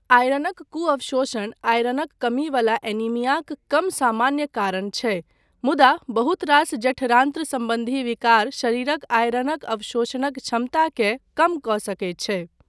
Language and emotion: Maithili, neutral